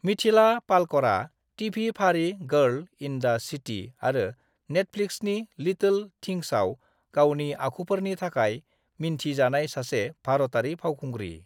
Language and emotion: Bodo, neutral